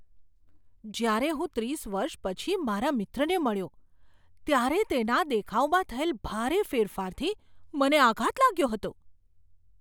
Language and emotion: Gujarati, surprised